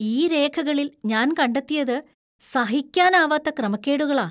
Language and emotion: Malayalam, disgusted